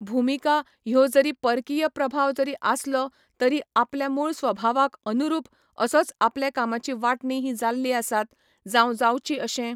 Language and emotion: Goan Konkani, neutral